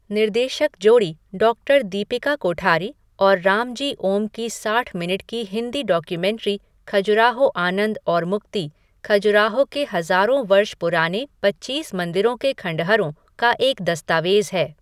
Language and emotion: Hindi, neutral